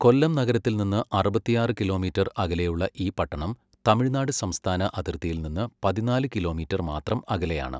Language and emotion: Malayalam, neutral